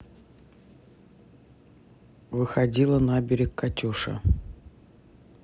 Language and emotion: Russian, neutral